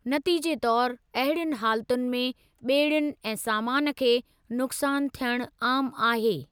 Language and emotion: Sindhi, neutral